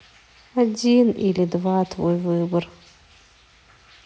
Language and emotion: Russian, sad